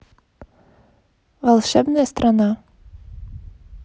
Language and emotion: Russian, neutral